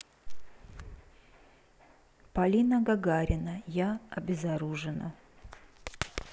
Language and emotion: Russian, neutral